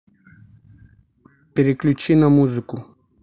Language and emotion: Russian, neutral